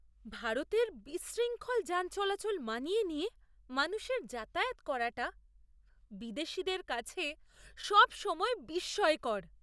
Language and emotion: Bengali, surprised